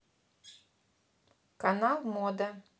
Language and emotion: Russian, neutral